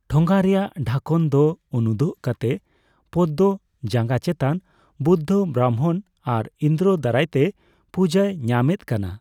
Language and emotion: Santali, neutral